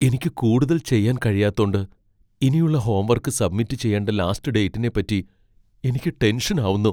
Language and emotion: Malayalam, fearful